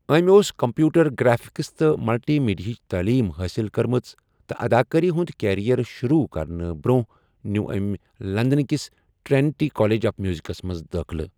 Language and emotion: Kashmiri, neutral